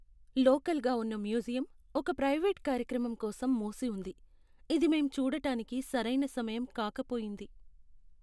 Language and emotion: Telugu, sad